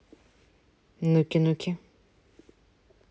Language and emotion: Russian, neutral